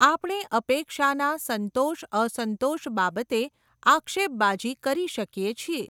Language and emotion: Gujarati, neutral